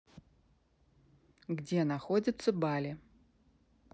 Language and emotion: Russian, neutral